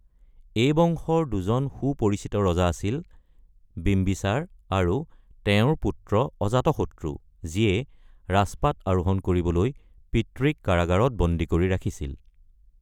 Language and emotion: Assamese, neutral